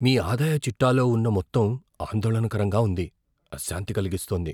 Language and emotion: Telugu, fearful